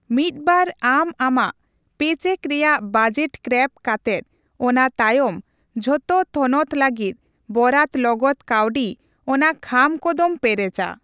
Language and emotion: Santali, neutral